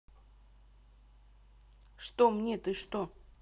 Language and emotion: Russian, neutral